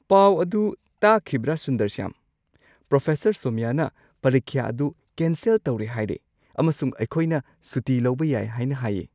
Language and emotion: Manipuri, surprised